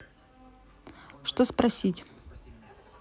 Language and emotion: Russian, neutral